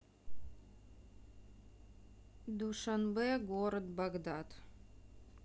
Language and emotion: Russian, neutral